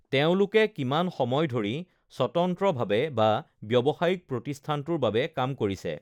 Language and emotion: Assamese, neutral